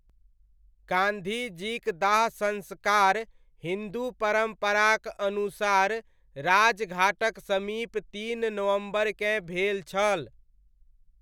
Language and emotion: Maithili, neutral